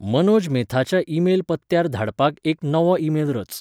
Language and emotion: Goan Konkani, neutral